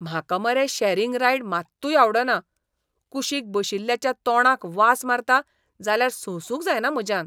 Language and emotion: Goan Konkani, disgusted